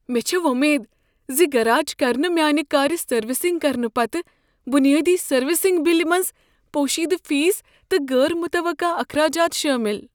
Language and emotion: Kashmiri, fearful